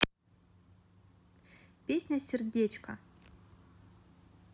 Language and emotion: Russian, positive